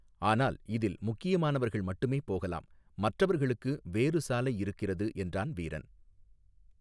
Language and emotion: Tamil, neutral